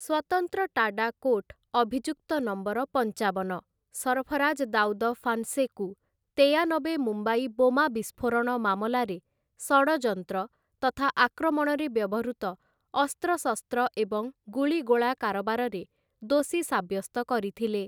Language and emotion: Odia, neutral